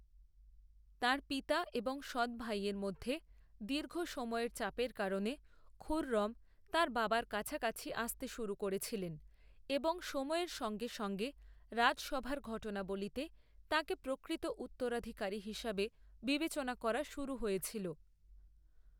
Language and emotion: Bengali, neutral